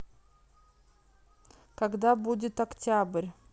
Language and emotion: Russian, neutral